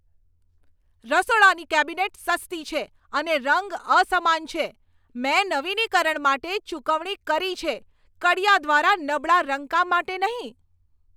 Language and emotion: Gujarati, angry